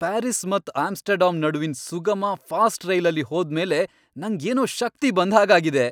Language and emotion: Kannada, happy